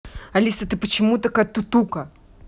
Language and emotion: Russian, angry